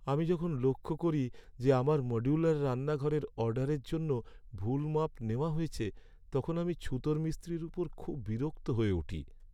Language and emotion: Bengali, sad